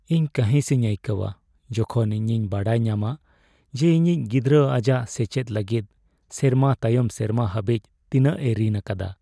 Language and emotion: Santali, sad